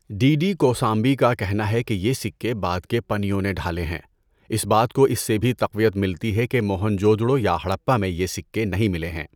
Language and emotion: Urdu, neutral